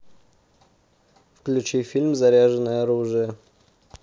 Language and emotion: Russian, neutral